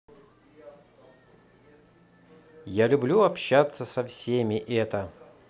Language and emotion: Russian, positive